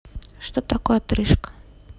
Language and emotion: Russian, neutral